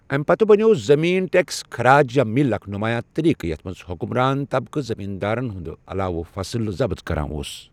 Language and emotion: Kashmiri, neutral